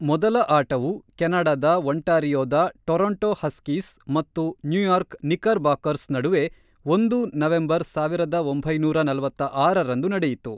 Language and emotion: Kannada, neutral